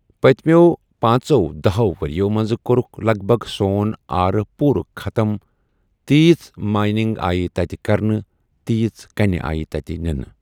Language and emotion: Kashmiri, neutral